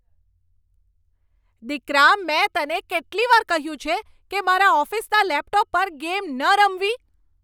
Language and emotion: Gujarati, angry